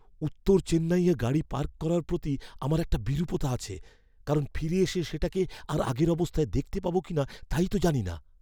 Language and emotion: Bengali, fearful